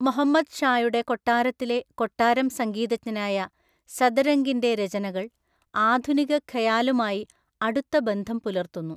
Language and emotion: Malayalam, neutral